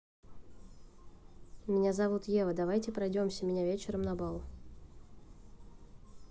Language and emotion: Russian, neutral